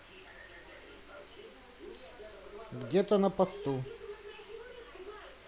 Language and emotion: Russian, neutral